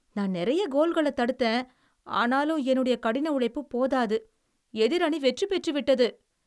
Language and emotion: Tamil, sad